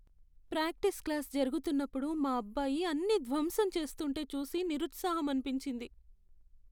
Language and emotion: Telugu, sad